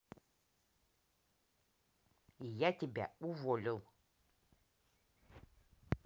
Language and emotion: Russian, angry